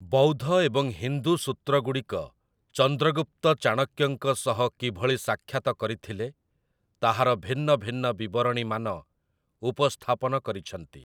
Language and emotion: Odia, neutral